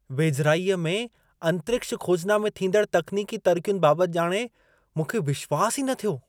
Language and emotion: Sindhi, surprised